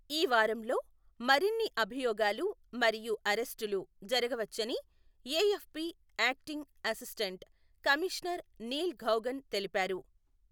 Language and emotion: Telugu, neutral